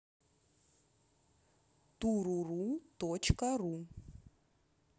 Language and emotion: Russian, neutral